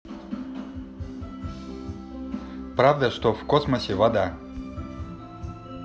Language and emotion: Russian, neutral